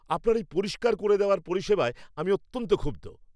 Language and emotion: Bengali, angry